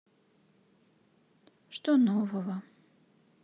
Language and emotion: Russian, sad